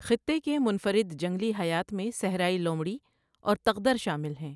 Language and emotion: Urdu, neutral